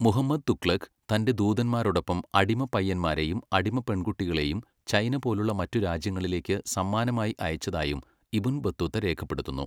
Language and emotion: Malayalam, neutral